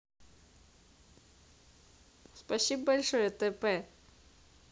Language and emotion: Russian, positive